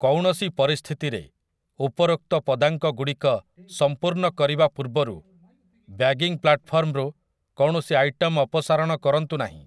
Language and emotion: Odia, neutral